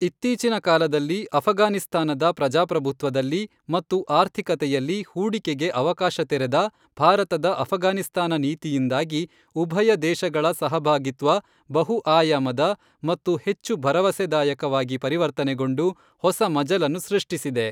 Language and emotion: Kannada, neutral